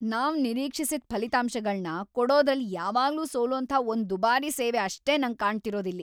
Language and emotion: Kannada, angry